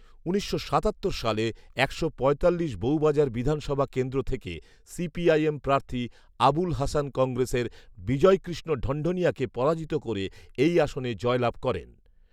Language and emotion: Bengali, neutral